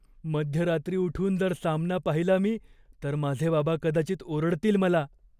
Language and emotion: Marathi, fearful